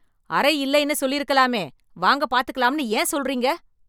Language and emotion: Tamil, angry